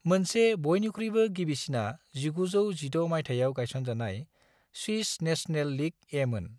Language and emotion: Bodo, neutral